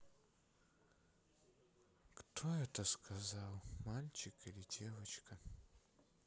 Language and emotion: Russian, sad